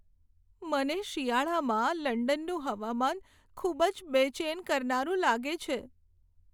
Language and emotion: Gujarati, sad